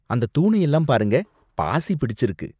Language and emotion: Tamil, disgusted